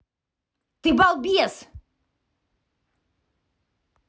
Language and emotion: Russian, angry